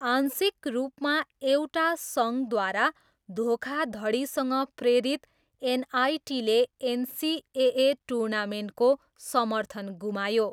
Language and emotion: Nepali, neutral